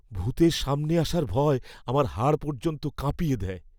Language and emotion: Bengali, fearful